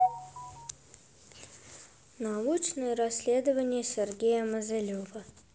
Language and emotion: Russian, neutral